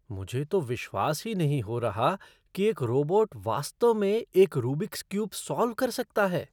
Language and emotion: Hindi, surprised